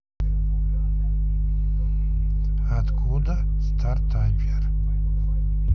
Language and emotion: Russian, neutral